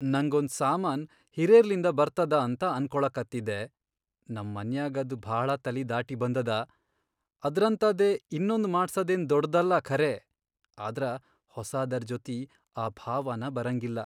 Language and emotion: Kannada, sad